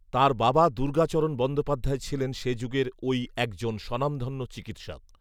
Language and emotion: Bengali, neutral